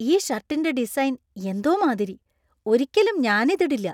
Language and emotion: Malayalam, disgusted